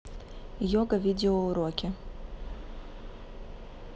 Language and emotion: Russian, neutral